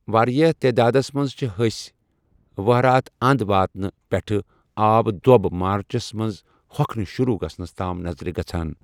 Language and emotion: Kashmiri, neutral